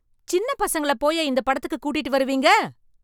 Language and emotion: Tamil, angry